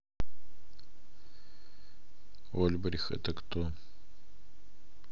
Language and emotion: Russian, neutral